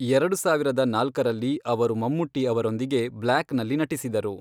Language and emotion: Kannada, neutral